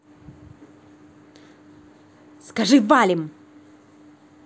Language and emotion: Russian, angry